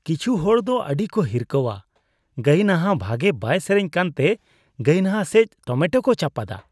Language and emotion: Santali, disgusted